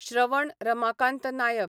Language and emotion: Goan Konkani, neutral